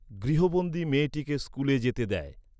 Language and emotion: Bengali, neutral